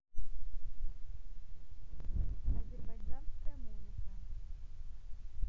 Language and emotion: Russian, neutral